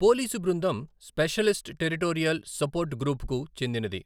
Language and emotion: Telugu, neutral